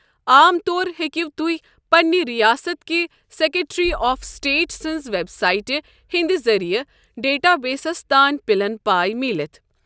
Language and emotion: Kashmiri, neutral